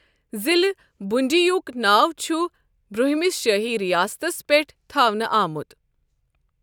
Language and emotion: Kashmiri, neutral